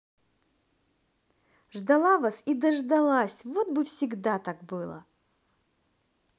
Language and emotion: Russian, positive